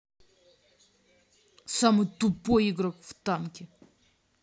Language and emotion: Russian, angry